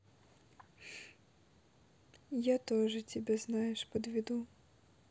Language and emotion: Russian, sad